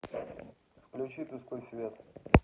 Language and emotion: Russian, neutral